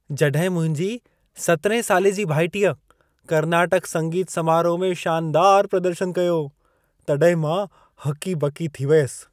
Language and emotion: Sindhi, surprised